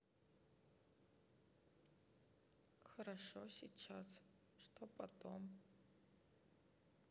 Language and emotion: Russian, sad